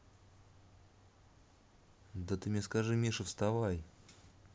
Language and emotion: Russian, neutral